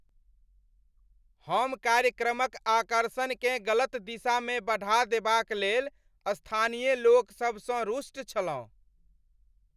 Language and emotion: Maithili, angry